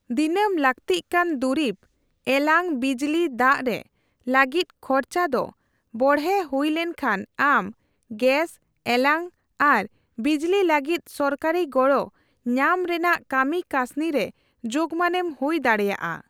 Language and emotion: Santali, neutral